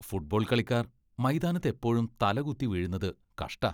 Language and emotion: Malayalam, disgusted